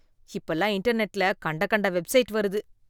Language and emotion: Tamil, disgusted